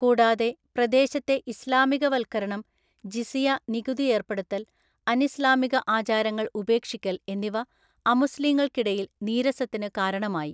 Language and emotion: Malayalam, neutral